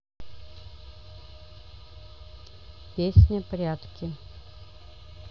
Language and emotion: Russian, neutral